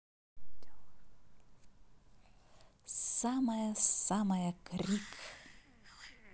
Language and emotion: Russian, positive